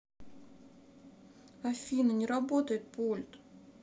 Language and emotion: Russian, sad